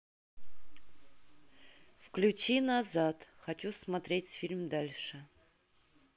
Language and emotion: Russian, neutral